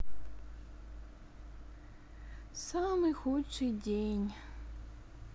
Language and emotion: Russian, sad